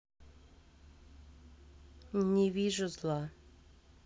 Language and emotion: Russian, neutral